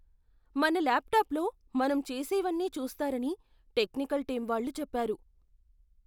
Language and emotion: Telugu, fearful